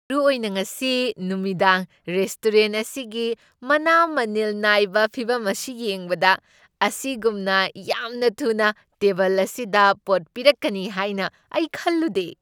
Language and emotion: Manipuri, surprised